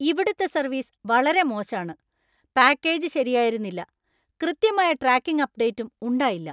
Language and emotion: Malayalam, angry